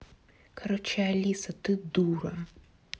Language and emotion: Russian, angry